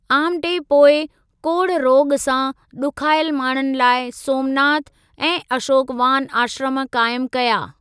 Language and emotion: Sindhi, neutral